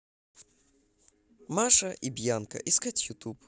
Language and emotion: Russian, positive